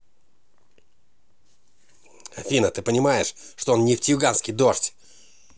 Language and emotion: Russian, angry